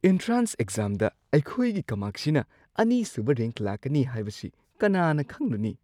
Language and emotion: Manipuri, surprised